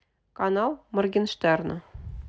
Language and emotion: Russian, neutral